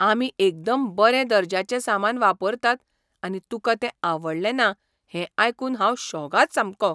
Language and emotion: Goan Konkani, surprised